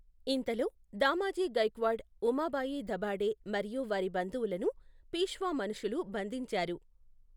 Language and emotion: Telugu, neutral